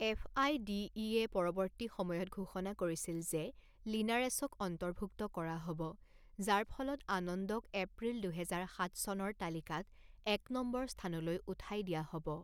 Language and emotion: Assamese, neutral